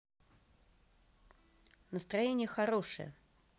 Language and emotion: Russian, neutral